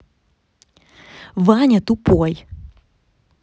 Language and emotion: Russian, angry